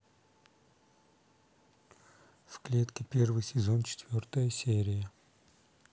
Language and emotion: Russian, neutral